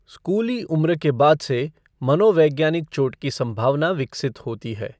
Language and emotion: Hindi, neutral